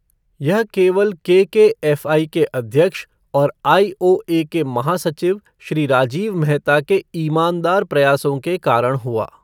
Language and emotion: Hindi, neutral